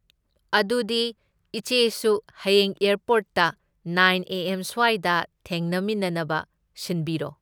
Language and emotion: Manipuri, neutral